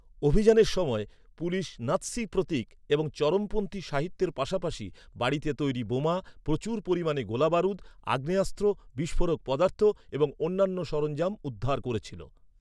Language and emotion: Bengali, neutral